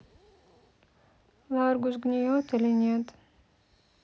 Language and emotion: Russian, sad